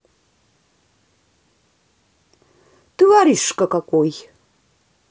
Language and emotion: Russian, angry